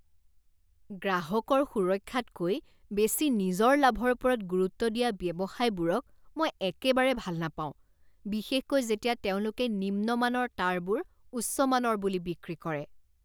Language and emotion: Assamese, disgusted